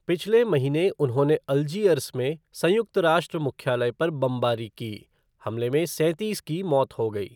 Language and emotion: Hindi, neutral